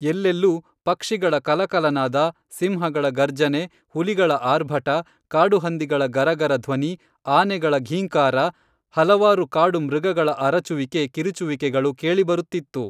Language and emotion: Kannada, neutral